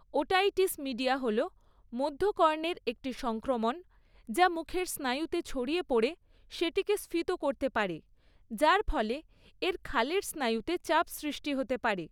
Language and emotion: Bengali, neutral